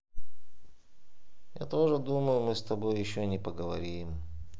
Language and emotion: Russian, sad